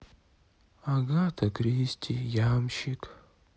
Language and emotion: Russian, sad